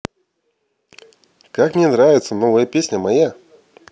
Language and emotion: Russian, positive